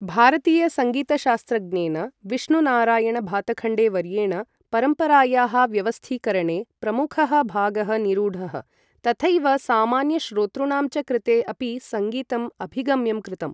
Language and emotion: Sanskrit, neutral